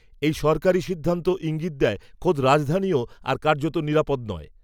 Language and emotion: Bengali, neutral